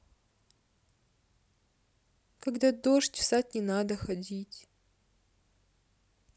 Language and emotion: Russian, sad